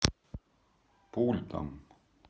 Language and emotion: Russian, neutral